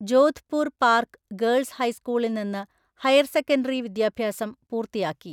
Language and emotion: Malayalam, neutral